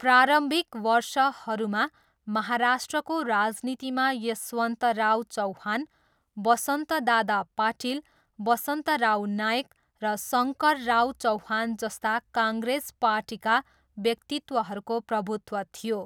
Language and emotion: Nepali, neutral